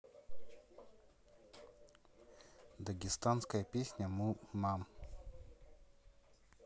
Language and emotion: Russian, neutral